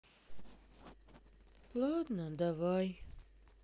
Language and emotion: Russian, sad